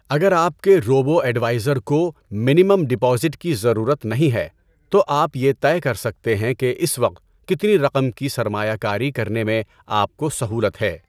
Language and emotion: Urdu, neutral